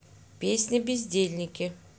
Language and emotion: Russian, neutral